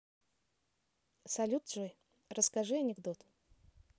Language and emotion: Russian, neutral